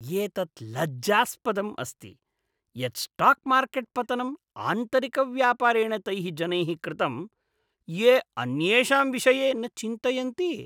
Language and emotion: Sanskrit, disgusted